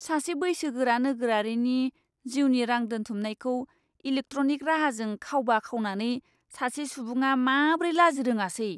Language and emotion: Bodo, disgusted